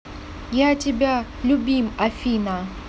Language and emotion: Russian, neutral